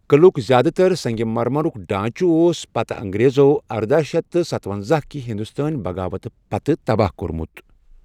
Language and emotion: Kashmiri, neutral